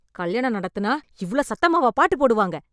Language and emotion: Tamil, angry